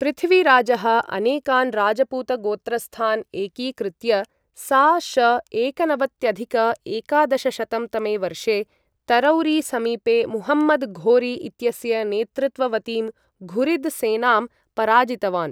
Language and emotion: Sanskrit, neutral